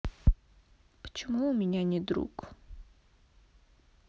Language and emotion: Russian, sad